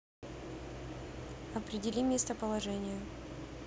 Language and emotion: Russian, neutral